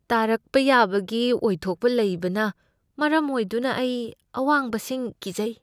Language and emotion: Manipuri, fearful